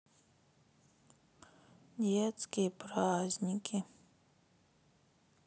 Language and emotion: Russian, sad